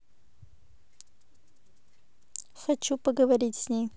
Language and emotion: Russian, neutral